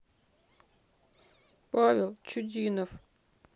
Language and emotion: Russian, sad